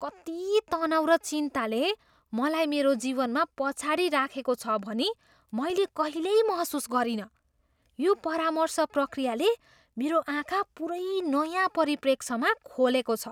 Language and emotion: Nepali, surprised